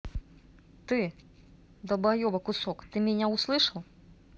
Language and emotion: Russian, angry